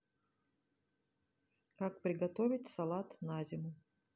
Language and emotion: Russian, neutral